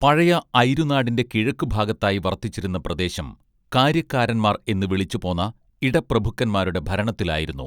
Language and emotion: Malayalam, neutral